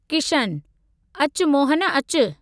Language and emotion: Sindhi, neutral